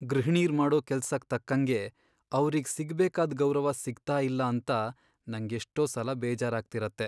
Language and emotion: Kannada, sad